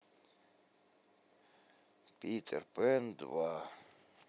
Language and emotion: Russian, sad